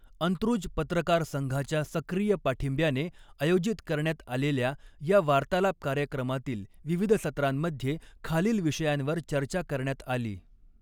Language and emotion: Marathi, neutral